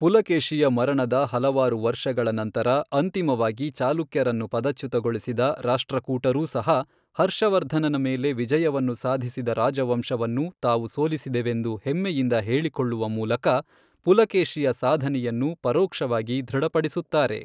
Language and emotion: Kannada, neutral